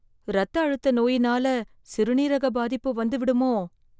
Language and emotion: Tamil, fearful